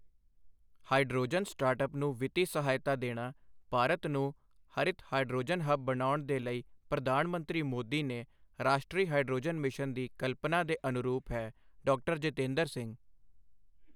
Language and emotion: Punjabi, neutral